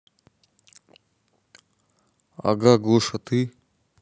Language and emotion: Russian, neutral